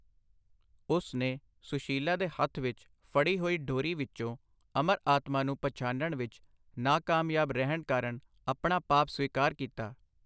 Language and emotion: Punjabi, neutral